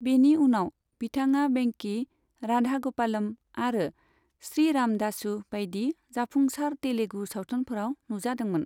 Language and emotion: Bodo, neutral